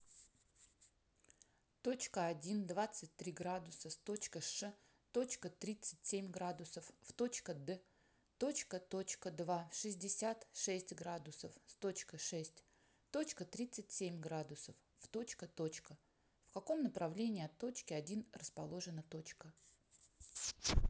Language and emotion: Russian, neutral